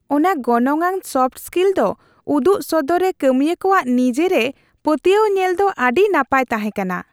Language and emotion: Santali, happy